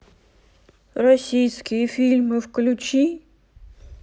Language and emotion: Russian, sad